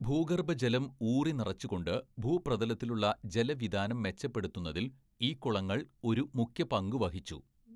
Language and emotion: Malayalam, neutral